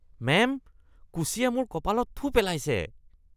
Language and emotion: Assamese, disgusted